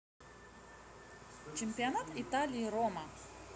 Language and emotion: Russian, positive